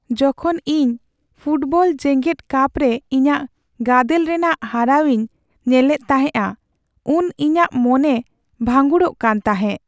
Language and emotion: Santali, sad